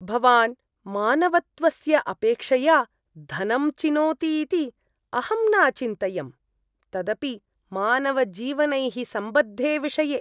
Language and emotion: Sanskrit, disgusted